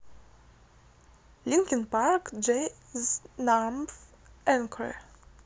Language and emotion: Russian, neutral